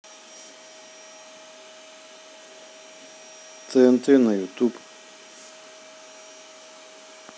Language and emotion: Russian, neutral